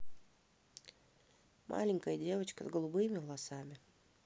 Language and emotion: Russian, neutral